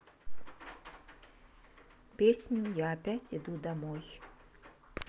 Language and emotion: Russian, neutral